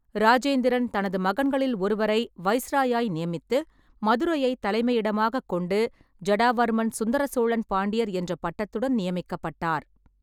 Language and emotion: Tamil, neutral